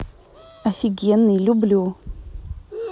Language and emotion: Russian, neutral